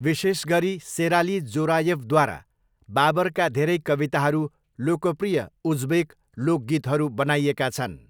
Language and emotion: Nepali, neutral